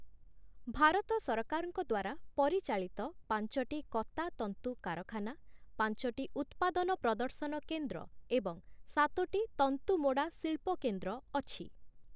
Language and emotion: Odia, neutral